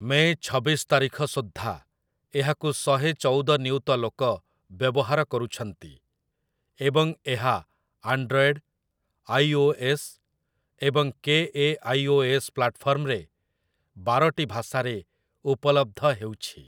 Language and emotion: Odia, neutral